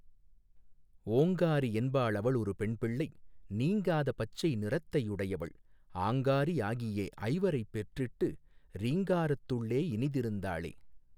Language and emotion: Tamil, neutral